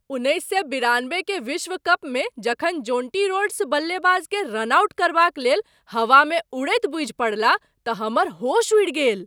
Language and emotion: Maithili, surprised